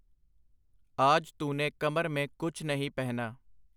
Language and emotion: Punjabi, neutral